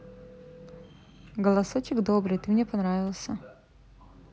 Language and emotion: Russian, positive